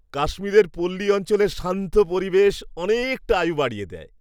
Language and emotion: Bengali, happy